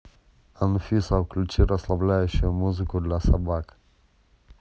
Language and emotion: Russian, neutral